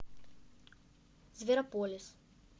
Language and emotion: Russian, neutral